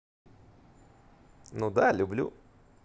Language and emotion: Russian, positive